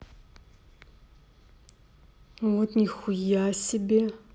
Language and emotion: Russian, neutral